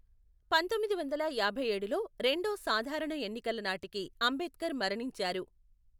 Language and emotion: Telugu, neutral